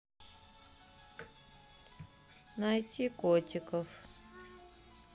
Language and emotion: Russian, sad